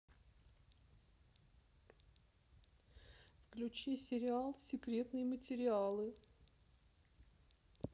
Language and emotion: Russian, sad